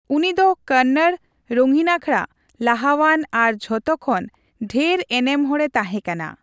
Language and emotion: Santali, neutral